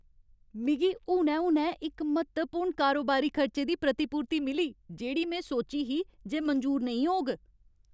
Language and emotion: Dogri, happy